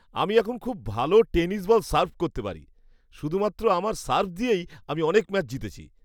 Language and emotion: Bengali, happy